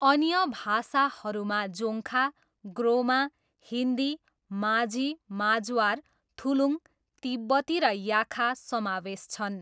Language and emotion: Nepali, neutral